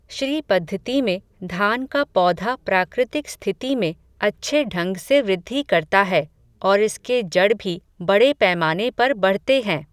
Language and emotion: Hindi, neutral